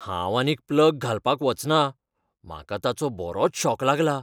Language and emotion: Goan Konkani, fearful